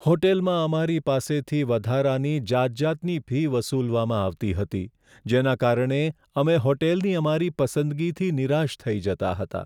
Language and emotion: Gujarati, sad